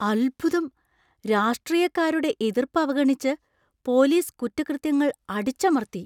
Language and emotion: Malayalam, surprised